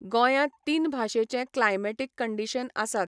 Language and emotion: Goan Konkani, neutral